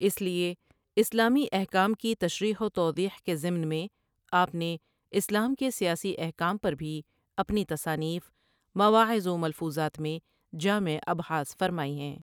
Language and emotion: Urdu, neutral